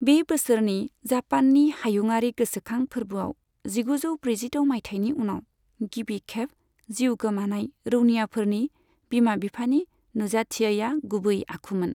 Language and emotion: Bodo, neutral